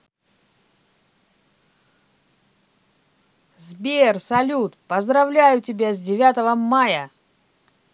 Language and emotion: Russian, positive